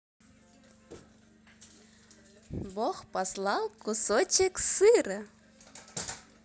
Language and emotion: Russian, positive